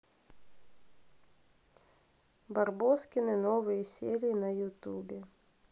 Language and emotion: Russian, neutral